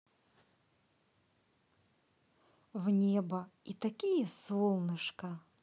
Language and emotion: Russian, positive